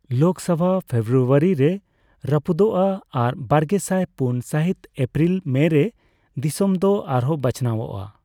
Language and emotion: Santali, neutral